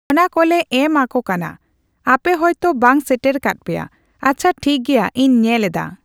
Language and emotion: Santali, neutral